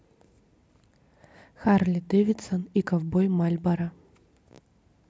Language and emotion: Russian, neutral